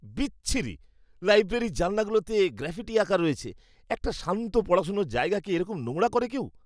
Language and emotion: Bengali, disgusted